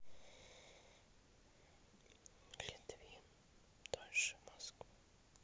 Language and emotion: Russian, neutral